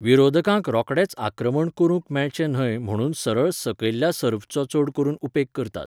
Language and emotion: Goan Konkani, neutral